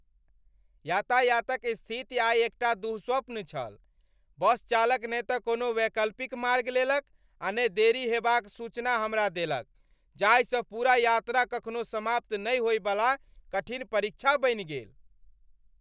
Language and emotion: Maithili, angry